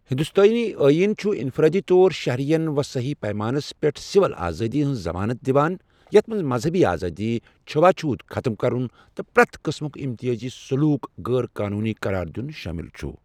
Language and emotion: Kashmiri, neutral